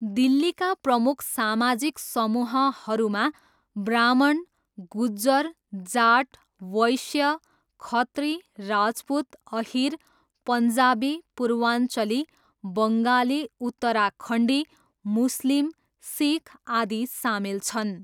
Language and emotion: Nepali, neutral